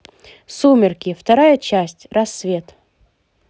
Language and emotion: Russian, positive